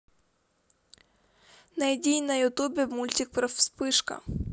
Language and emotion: Russian, neutral